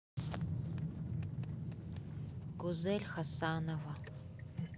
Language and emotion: Russian, neutral